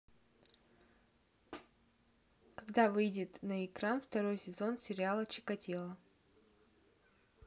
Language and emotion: Russian, neutral